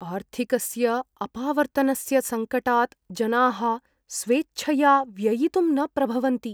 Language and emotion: Sanskrit, fearful